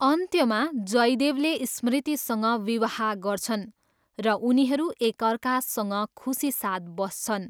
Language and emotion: Nepali, neutral